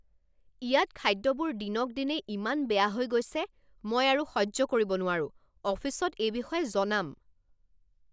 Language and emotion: Assamese, angry